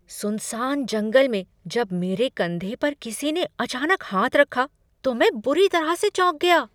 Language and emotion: Hindi, surprised